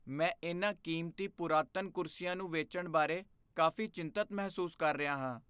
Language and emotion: Punjabi, fearful